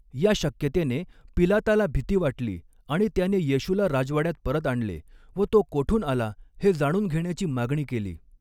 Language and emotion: Marathi, neutral